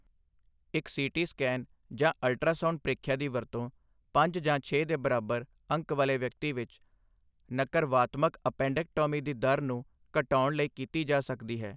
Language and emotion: Punjabi, neutral